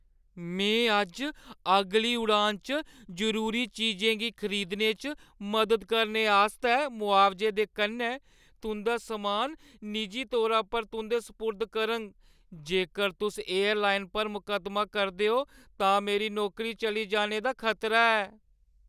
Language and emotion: Dogri, fearful